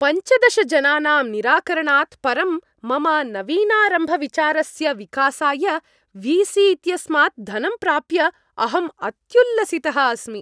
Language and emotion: Sanskrit, happy